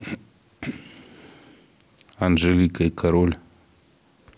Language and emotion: Russian, neutral